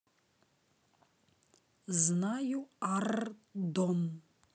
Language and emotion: Russian, neutral